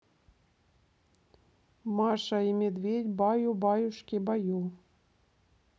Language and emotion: Russian, neutral